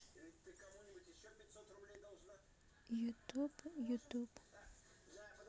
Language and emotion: Russian, sad